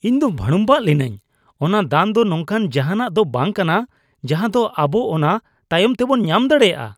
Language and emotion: Santali, disgusted